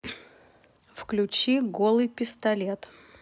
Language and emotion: Russian, neutral